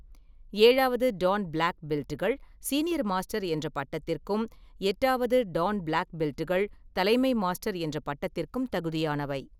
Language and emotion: Tamil, neutral